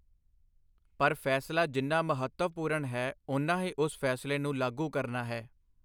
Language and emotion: Punjabi, neutral